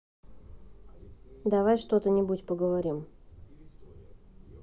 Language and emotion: Russian, neutral